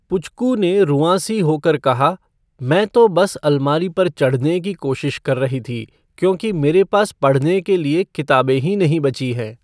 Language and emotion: Hindi, neutral